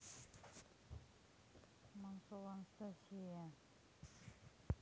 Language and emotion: Russian, neutral